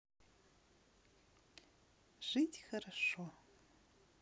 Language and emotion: Russian, positive